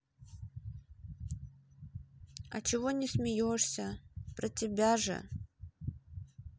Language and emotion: Russian, sad